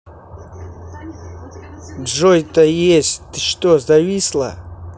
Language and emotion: Russian, angry